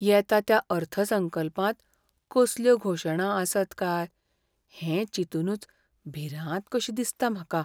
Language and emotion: Goan Konkani, fearful